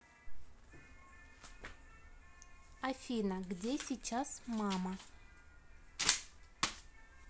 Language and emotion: Russian, neutral